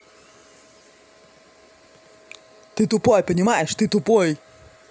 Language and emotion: Russian, angry